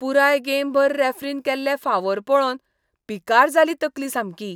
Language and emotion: Goan Konkani, disgusted